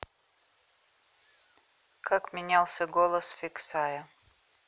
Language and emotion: Russian, neutral